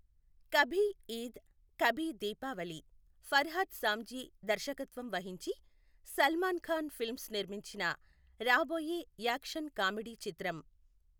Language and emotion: Telugu, neutral